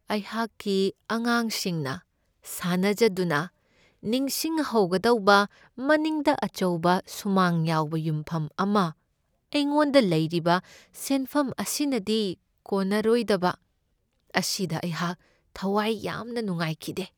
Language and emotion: Manipuri, sad